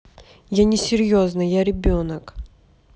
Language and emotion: Russian, neutral